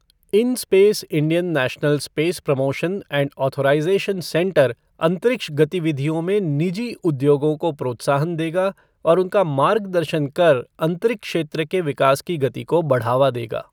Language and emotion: Hindi, neutral